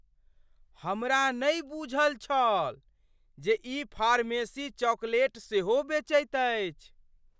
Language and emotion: Maithili, surprised